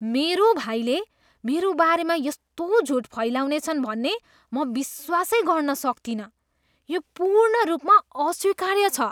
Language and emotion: Nepali, disgusted